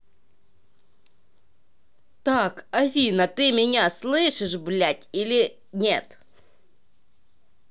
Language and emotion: Russian, angry